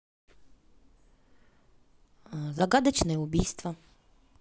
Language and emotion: Russian, neutral